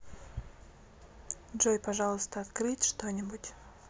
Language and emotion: Russian, neutral